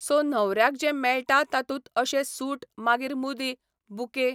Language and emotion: Goan Konkani, neutral